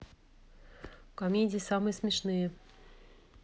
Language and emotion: Russian, neutral